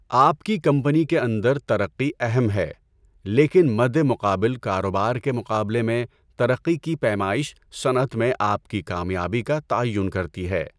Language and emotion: Urdu, neutral